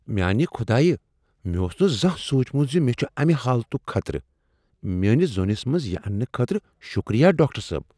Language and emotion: Kashmiri, surprised